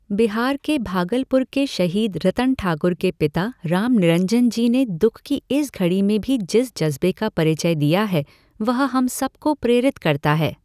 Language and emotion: Hindi, neutral